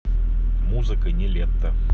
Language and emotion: Russian, neutral